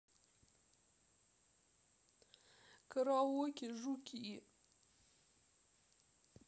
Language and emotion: Russian, sad